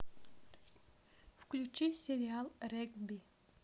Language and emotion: Russian, neutral